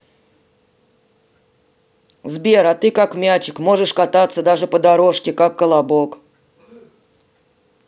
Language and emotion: Russian, neutral